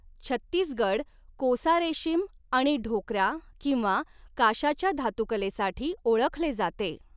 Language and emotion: Marathi, neutral